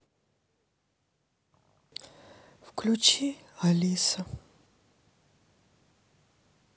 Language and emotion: Russian, sad